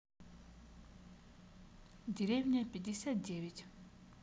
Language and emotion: Russian, neutral